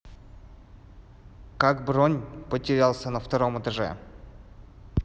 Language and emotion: Russian, neutral